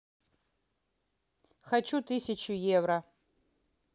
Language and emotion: Russian, neutral